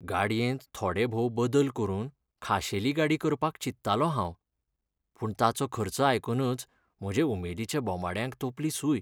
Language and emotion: Goan Konkani, sad